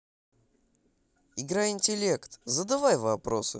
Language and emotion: Russian, positive